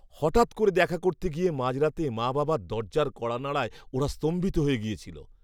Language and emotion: Bengali, surprised